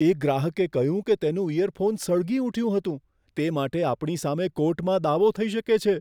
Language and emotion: Gujarati, fearful